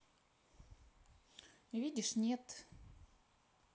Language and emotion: Russian, neutral